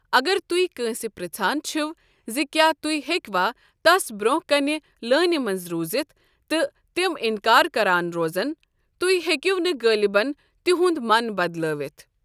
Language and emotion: Kashmiri, neutral